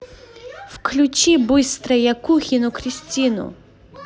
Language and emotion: Russian, angry